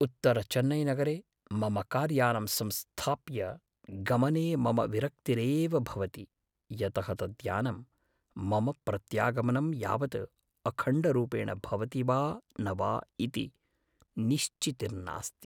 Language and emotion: Sanskrit, fearful